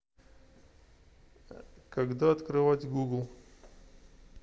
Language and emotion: Russian, neutral